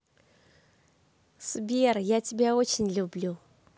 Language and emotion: Russian, positive